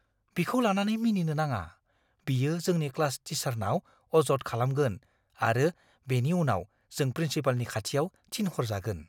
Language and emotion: Bodo, fearful